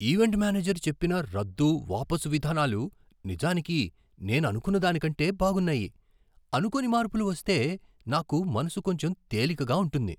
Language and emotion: Telugu, surprised